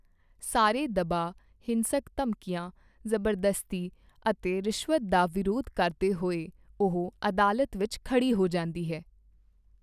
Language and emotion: Punjabi, neutral